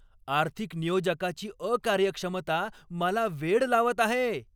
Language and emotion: Marathi, angry